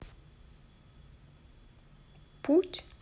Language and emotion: Russian, neutral